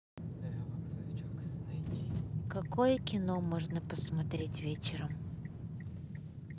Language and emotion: Russian, neutral